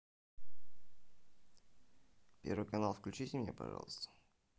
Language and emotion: Russian, neutral